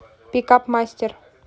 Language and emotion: Russian, neutral